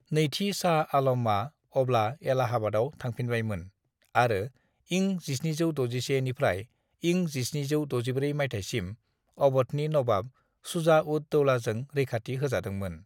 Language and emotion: Bodo, neutral